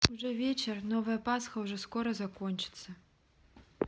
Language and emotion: Russian, neutral